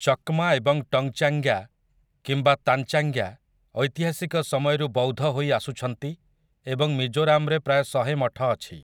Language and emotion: Odia, neutral